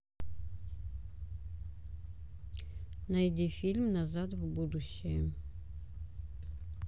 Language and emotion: Russian, neutral